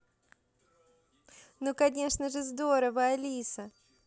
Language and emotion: Russian, positive